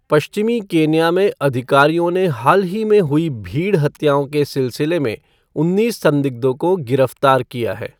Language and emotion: Hindi, neutral